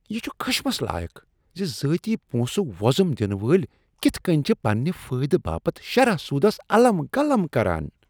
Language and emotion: Kashmiri, disgusted